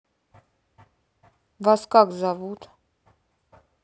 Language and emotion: Russian, neutral